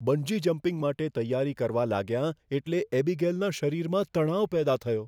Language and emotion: Gujarati, fearful